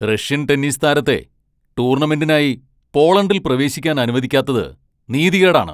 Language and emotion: Malayalam, angry